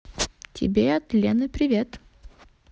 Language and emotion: Russian, positive